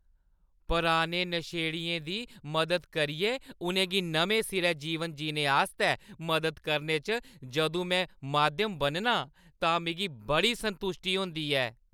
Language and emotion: Dogri, happy